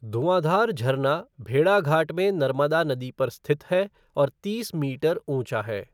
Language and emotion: Hindi, neutral